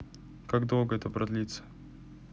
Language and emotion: Russian, neutral